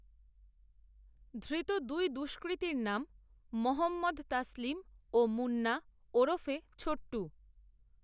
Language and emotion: Bengali, neutral